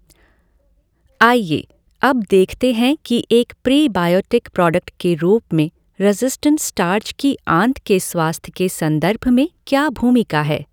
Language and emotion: Hindi, neutral